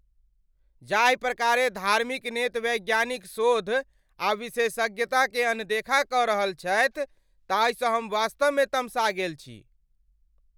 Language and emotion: Maithili, angry